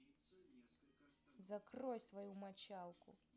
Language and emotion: Russian, angry